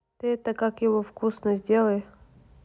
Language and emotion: Russian, neutral